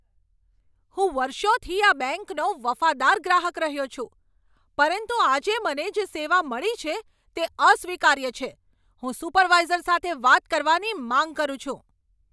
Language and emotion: Gujarati, angry